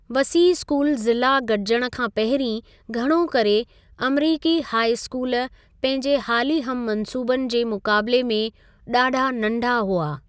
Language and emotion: Sindhi, neutral